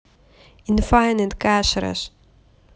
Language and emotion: Russian, positive